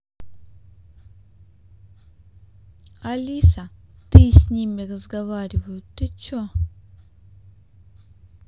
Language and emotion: Russian, neutral